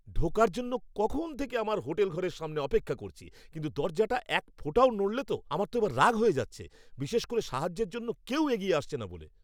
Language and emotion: Bengali, angry